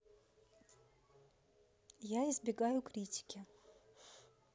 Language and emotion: Russian, neutral